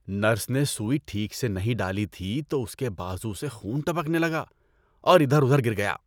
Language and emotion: Urdu, disgusted